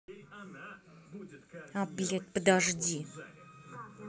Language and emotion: Russian, angry